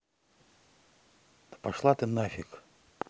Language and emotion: Russian, angry